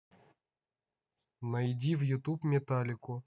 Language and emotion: Russian, neutral